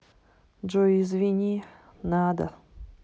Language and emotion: Russian, sad